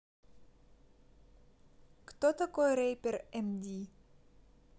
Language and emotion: Russian, neutral